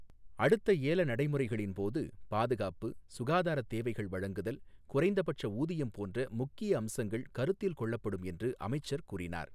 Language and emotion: Tamil, neutral